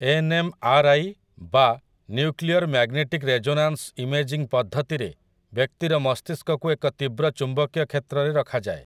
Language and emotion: Odia, neutral